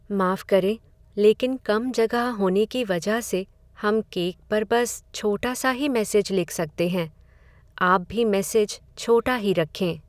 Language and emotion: Hindi, sad